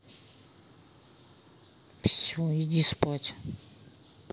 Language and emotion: Russian, angry